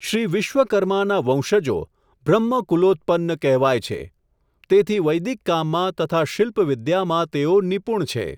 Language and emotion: Gujarati, neutral